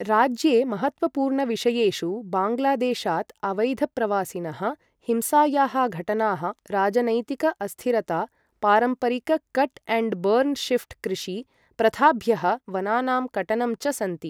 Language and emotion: Sanskrit, neutral